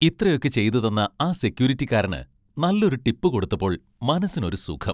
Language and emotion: Malayalam, happy